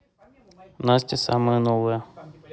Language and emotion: Russian, neutral